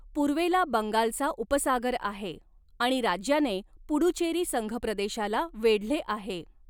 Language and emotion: Marathi, neutral